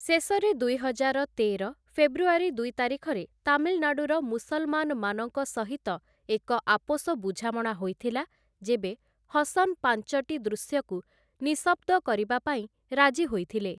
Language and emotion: Odia, neutral